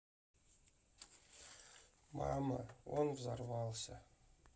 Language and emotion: Russian, sad